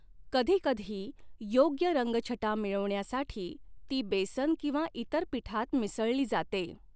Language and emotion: Marathi, neutral